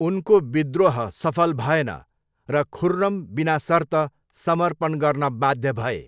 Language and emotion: Nepali, neutral